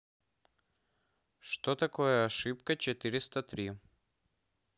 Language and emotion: Russian, neutral